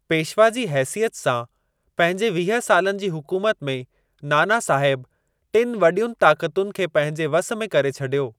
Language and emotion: Sindhi, neutral